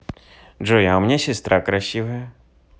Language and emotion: Russian, positive